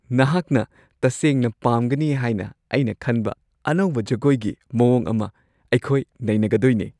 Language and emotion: Manipuri, happy